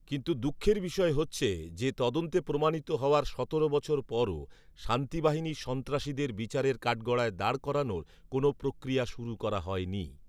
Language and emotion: Bengali, neutral